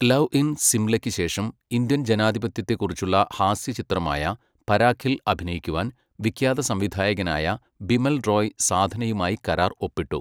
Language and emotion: Malayalam, neutral